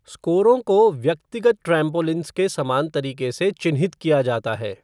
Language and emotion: Hindi, neutral